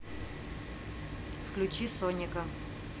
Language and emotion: Russian, neutral